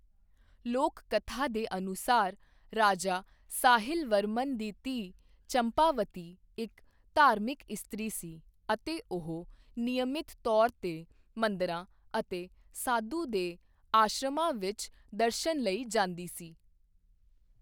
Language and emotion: Punjabi, neutral